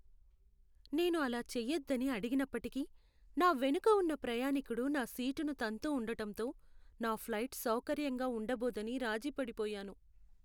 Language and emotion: Telugu, sad